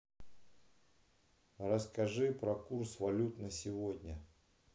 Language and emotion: Russian, neutral